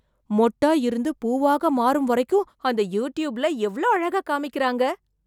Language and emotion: Tamil, surprised